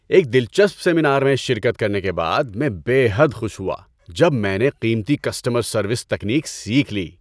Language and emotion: Urdu, happy